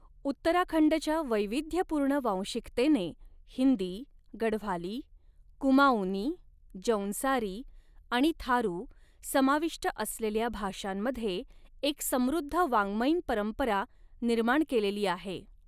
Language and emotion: Marathi, neutral